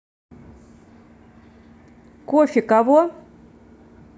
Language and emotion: Russian, neutral